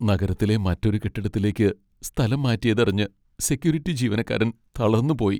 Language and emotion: Malayalam, sad